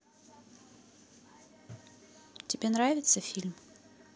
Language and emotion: Russian, neutral